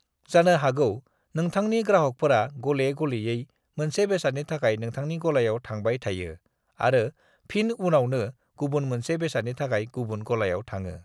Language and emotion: Bodo, neutral